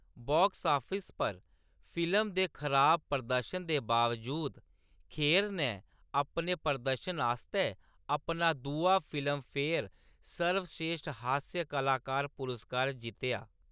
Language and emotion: Dogri, neutral